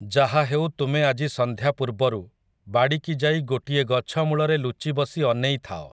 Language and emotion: Odia, neutral